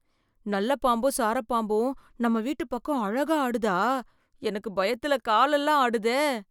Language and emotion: Tamil, fearful